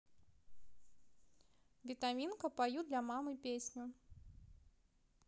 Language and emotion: Russian, positive